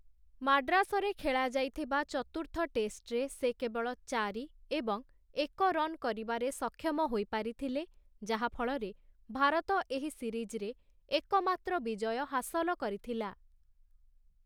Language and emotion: Odia, neutral